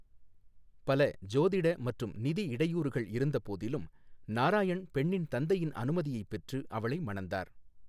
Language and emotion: Tamil, neutral